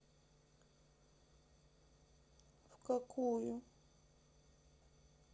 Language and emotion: Russian, sad